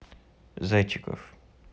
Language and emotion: Russian, neutral